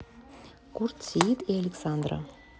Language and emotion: Russian, neutral